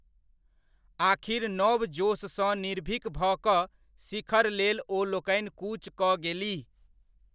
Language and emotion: Maithili, neutral